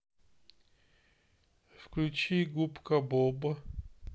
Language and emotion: Russian, sad